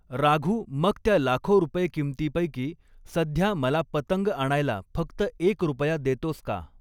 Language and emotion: Marathi, neutral